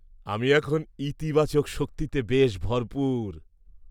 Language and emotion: Bengali, happy